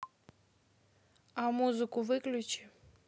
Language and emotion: Russian, neutral